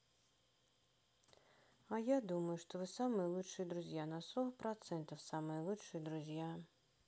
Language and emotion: Russian, sad